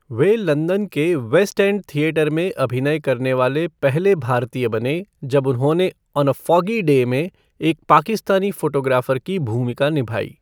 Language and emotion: Hindi, neutral